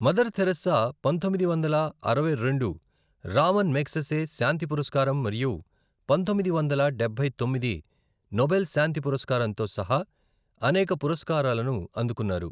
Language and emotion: Telugu, neutral